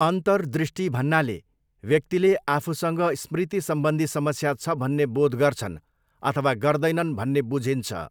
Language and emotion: Nepali, neutral